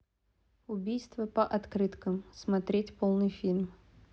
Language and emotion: Russian, neutral